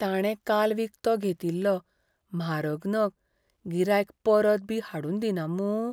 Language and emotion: Goan Konkani, fearful